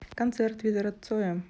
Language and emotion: Russian, neutral